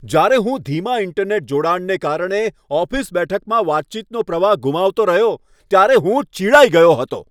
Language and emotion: Gujarati, angry